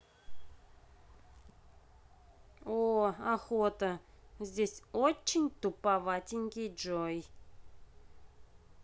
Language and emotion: Russian, neutral